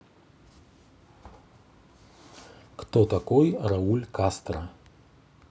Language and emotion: Russian, neutral